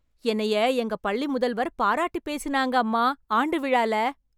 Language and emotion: Tamil, happy